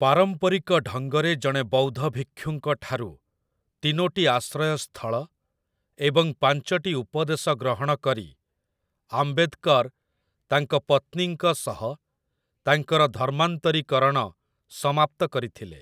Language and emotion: Odia, neutral